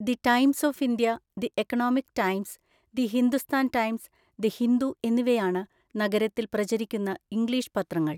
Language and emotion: Malayalam, neutral